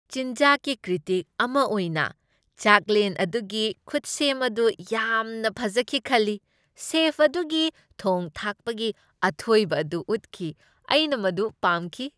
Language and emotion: Manipuri, happy